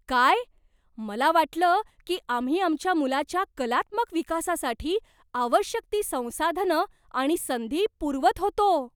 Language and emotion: Marathi, surprised